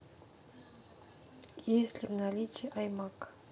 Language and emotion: Russian, neutral